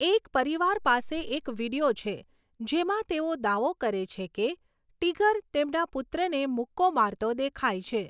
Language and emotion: Gujarati, neutral